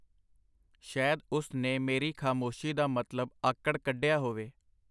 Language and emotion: Punjabi, neutral